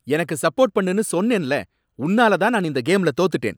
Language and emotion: Tamil, angry